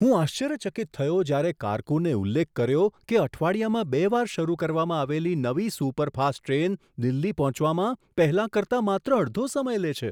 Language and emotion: Gujarati, surprised